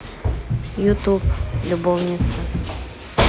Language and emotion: Russian, neutral